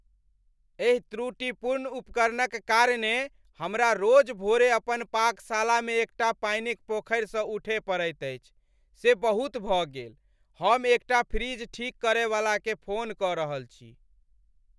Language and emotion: Maithili, angry